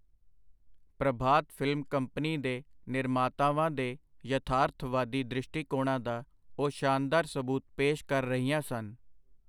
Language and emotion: Punjabi, neutral